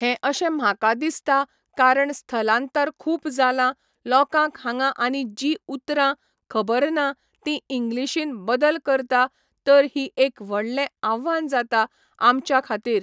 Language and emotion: Goan Konkani, neutral